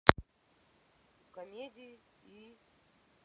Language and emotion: Russian, neutral